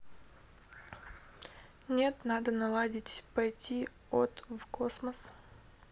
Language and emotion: Russian, neutral